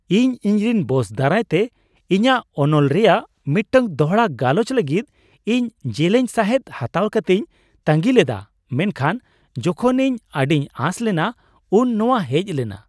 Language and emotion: Santali, surprised